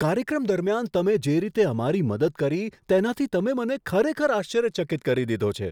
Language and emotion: Gujarati, surprised